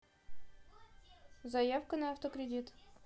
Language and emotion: Russian, neutral